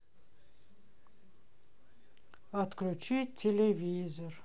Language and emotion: Russian, sad